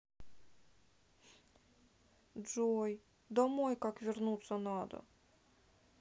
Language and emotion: Russian, sad